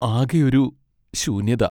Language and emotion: Malayalam, sad